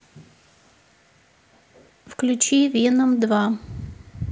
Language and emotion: Russian, neutral